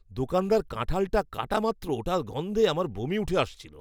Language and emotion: Bengali, disgusted